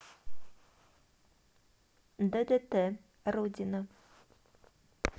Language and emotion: Russian, neutral